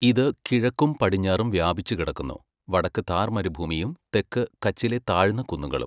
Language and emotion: Malayalam, neutral